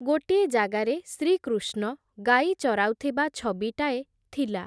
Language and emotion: Odia, neutral